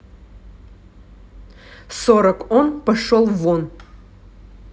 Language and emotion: Russian, angry